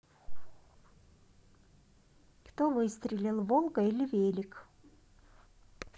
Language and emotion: Russian, neutral